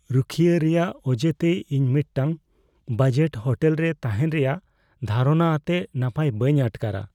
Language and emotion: Santali, fearful